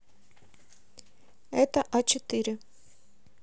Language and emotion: Russian, neutral